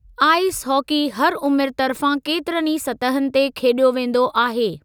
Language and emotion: Sindhi, neutral